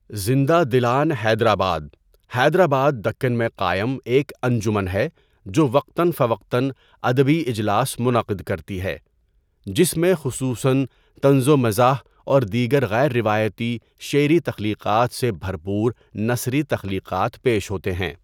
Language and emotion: Urdu, neutral